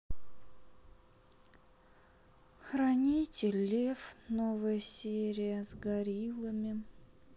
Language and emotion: Russian, sad